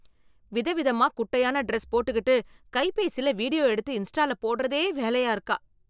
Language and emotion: Tamil, disgusted